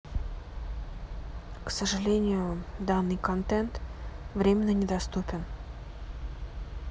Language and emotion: Russian, sad